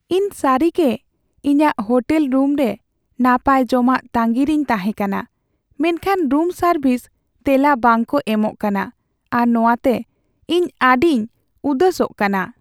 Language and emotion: Santali, sad